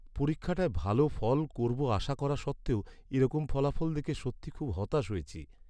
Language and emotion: Bengali, sad